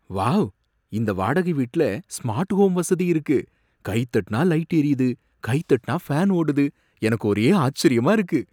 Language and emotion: Tamil, surprised